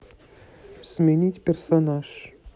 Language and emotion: Russian, neutral